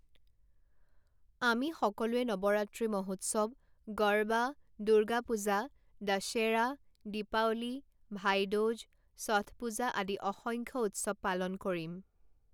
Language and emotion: Assamese, neutral